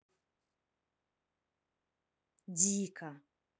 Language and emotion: Russian, neutral